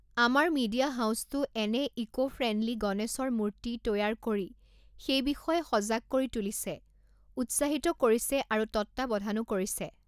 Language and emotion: Assamese, neutral